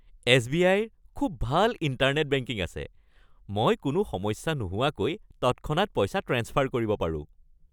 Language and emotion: Assamese, happy